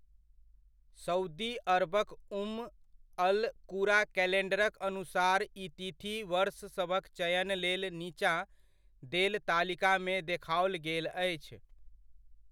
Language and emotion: Maithili, neutral